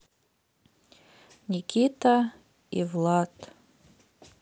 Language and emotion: Russian, sad